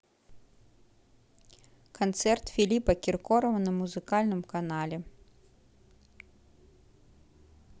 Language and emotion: Russian, neutral